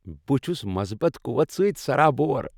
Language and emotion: Kashmiri, happy